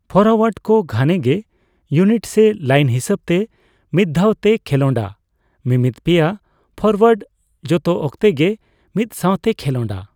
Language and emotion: Santali, neutral